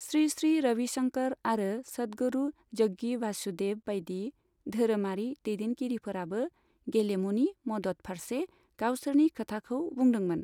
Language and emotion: Bodo, neutral